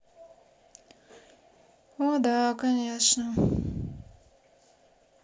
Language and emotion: Russian, sad